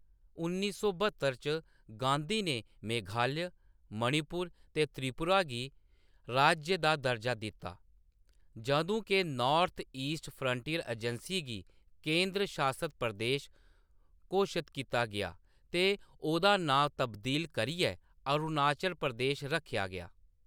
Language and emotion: Dogri, neutral